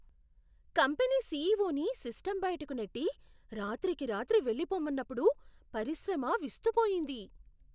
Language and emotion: Telugu, surprised